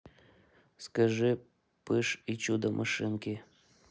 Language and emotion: Russian, neutral